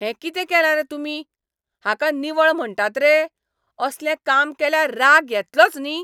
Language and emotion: Goan Konkani, angry